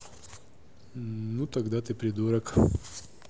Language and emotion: Russian, neutral